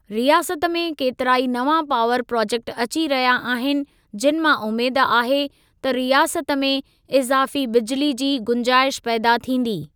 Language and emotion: Sindhi, neutral